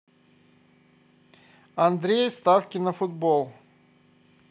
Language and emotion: Russian, positive